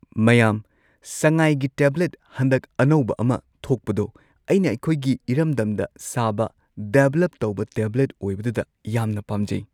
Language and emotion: Manipuri, neutral